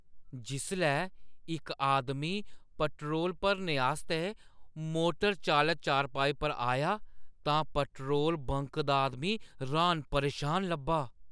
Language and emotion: Dogri, surprised